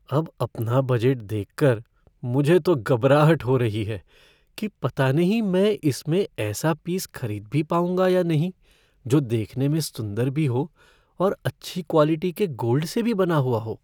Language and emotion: Hindi, fearful